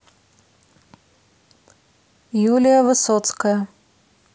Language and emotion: Russian, neutral